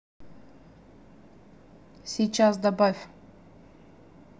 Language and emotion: Russian, neutral